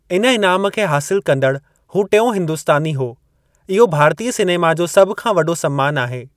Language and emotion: Sindhi, neutral